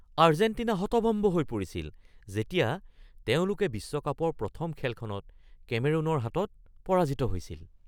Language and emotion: Assamese, surprised